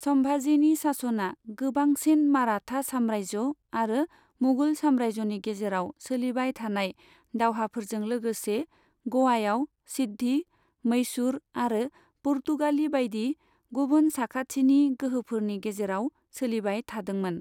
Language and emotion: Bodo, neutral